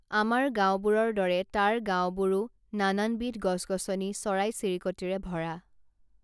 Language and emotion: Assamese, neutral